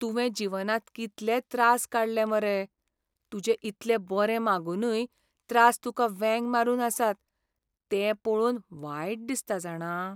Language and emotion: Goan Konkani, sad